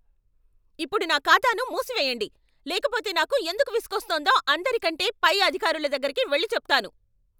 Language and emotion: Telugu, angry